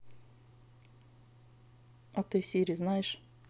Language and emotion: Russian, neutral